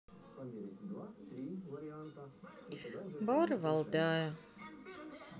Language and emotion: Russian, sad